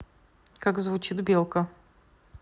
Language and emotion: Russian, neutral